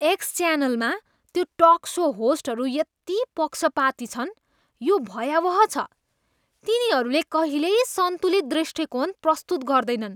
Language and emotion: Nepali, disgusted